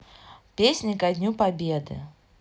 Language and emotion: Russian, neutral